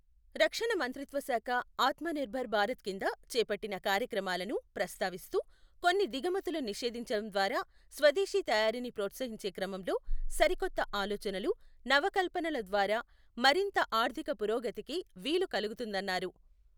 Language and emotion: Telugu, neutral